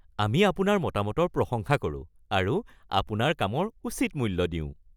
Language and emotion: Assamese, happy